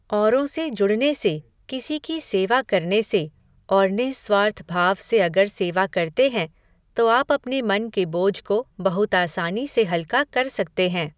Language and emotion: Hindi, neutral